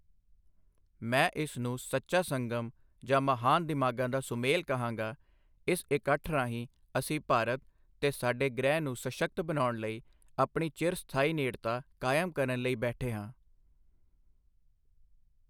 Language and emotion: Punjabi, neutral